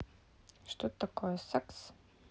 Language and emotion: Russian, neutral